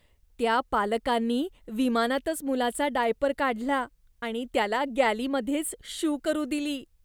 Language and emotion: Marathi, disgusted